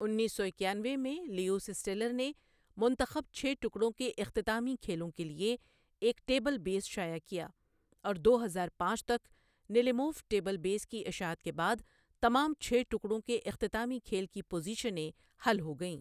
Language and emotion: Urdu, neutral